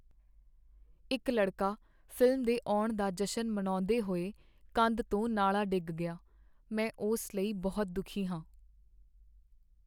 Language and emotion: Punjabi, sad